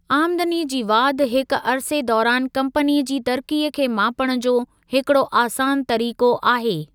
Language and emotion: Sindhi, neutral